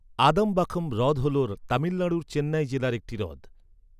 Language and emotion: Bengali, neutral